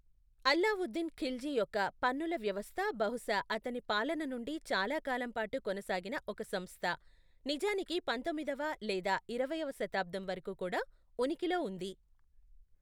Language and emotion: Telugu, neutral